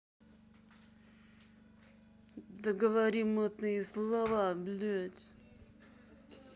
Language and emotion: Russian, angry